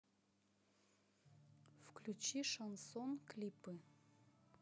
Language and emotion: Russian, neutral